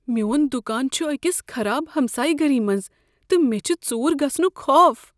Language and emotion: Kashmiri, fearful